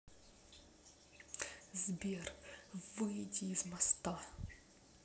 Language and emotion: Russian, angry